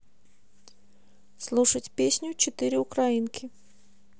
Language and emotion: Russian, neutral